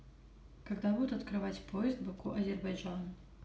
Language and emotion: Russian, neutral